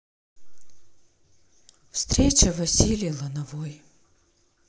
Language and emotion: Russian, sad